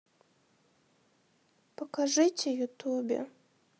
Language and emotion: Russian, sad